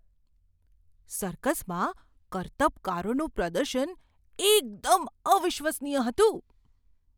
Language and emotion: Gujarati, surprised